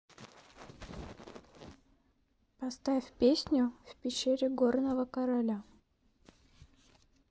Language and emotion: Russian, neutral